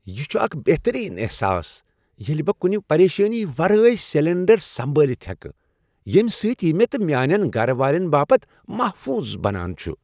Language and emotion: Kashmiri, happy